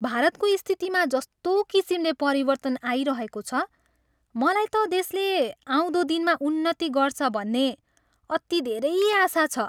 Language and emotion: Nepali, happy